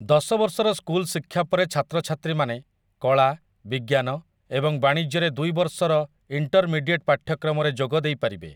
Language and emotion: Odia, neutral